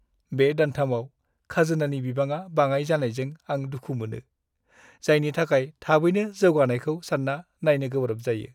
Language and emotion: Bodo, sad